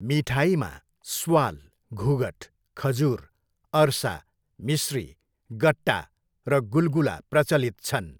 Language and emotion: Nepali, neutral